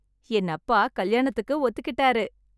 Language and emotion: Tamil, happy